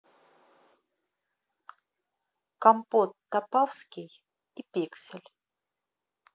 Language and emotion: Russian, neutral